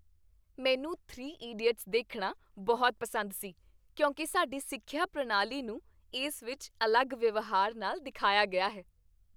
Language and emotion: Punjabi, happy